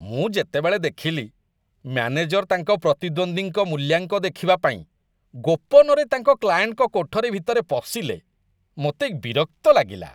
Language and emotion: Odia, disgusted